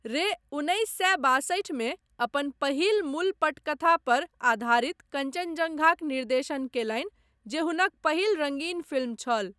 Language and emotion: Maithili, neutral